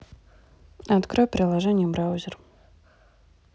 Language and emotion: Russian, neutral